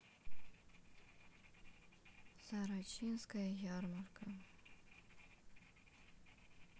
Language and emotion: Russian, sad